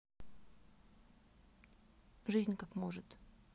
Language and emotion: Russian, neutral